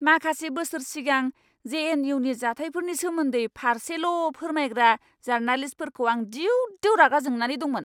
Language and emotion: Bodo, angry